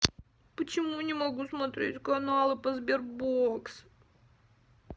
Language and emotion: Russian, sad